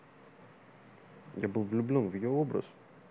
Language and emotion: Russian, neutral